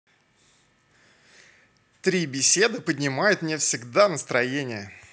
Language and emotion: Russian, positive